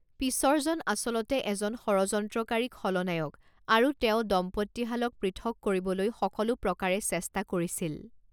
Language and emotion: Assamese, neutral